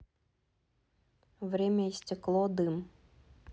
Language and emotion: Russian, neutral